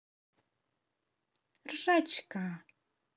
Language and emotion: Russian, positive